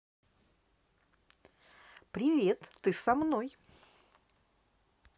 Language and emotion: Russian, positive